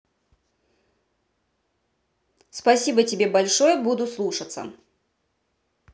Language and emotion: Russian, neutral